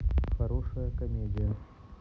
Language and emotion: Russian, neutral